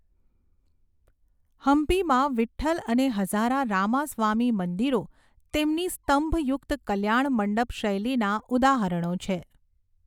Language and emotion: Gujarati, neutral